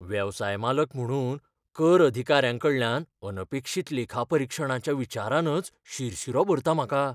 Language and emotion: Goan Konkani, fearful